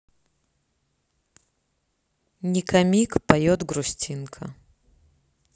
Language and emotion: Russian, neutral